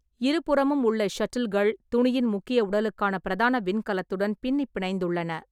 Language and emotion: Tamil, neutral